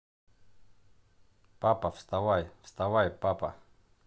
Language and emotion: Russian, neutral